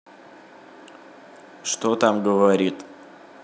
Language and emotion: Russian, neutral